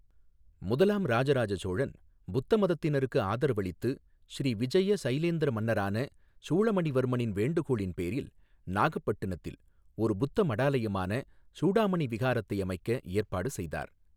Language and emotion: Tamil, neutral